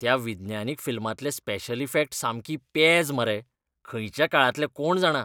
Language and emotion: Goan Konkani, disgusted